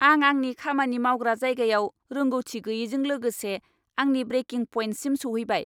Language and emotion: Bodo, angry